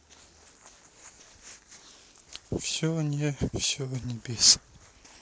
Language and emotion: Russian, sad